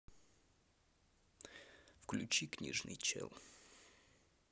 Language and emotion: Russian, neutral